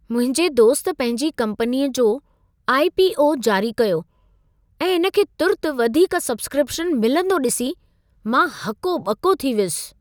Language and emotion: Sindhi, surprised